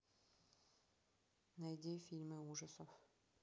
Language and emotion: Russian, neutral